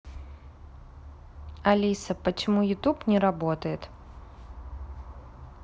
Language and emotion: Russian, neutral